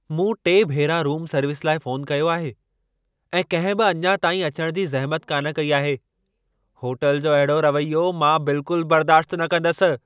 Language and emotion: Sindhi, angry